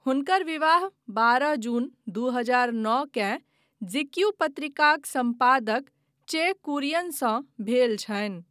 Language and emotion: Maithili, neutral